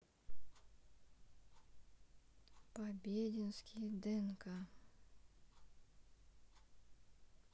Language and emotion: Russian, neutral